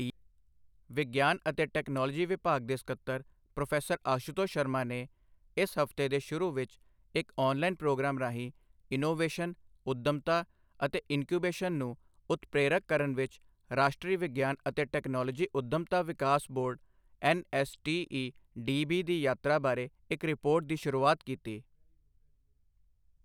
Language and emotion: Punjabi, neutral